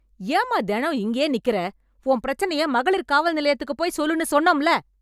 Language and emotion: Tamil, angry